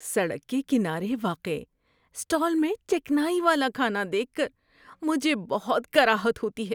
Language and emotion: Urdu, disgusted